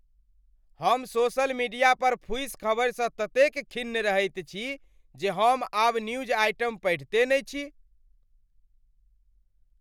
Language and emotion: Maithili, angry